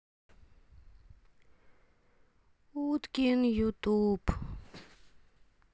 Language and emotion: Russian, sad